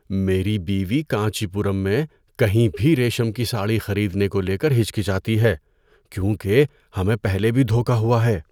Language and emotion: Urdu, fearful